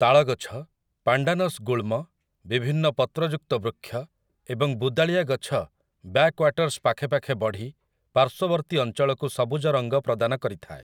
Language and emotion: Odia, neutral